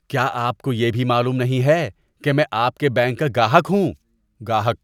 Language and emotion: Urdu, disgusted